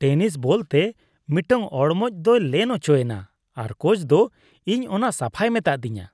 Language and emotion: Santali, disgusted